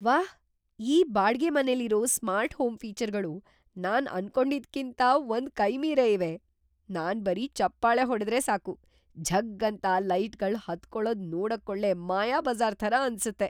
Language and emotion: Kannada, surprised